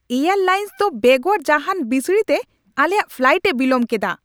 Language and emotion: Santali, angry